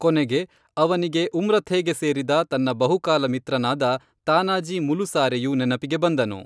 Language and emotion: Kannada, neutral